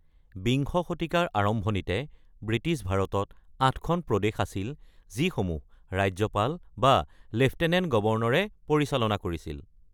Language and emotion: Assamese, neutral